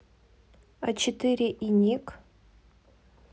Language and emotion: Russian, neutral